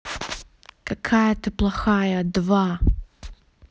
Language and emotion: Russian, angry